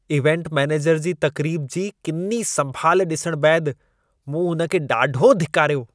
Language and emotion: Sindhi, disgusted